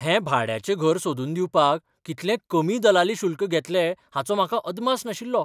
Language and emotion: Goan Konkani, surprised